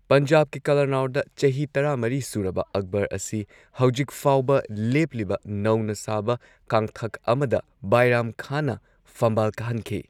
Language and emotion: Manipuri, neutral